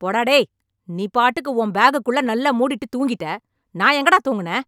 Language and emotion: Tamil, angry